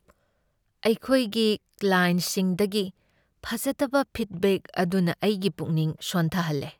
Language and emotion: Manipuri, sad